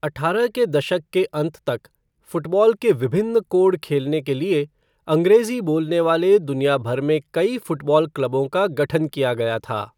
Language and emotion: Hindi, neutral